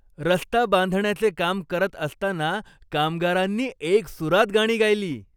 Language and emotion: Marathi, happy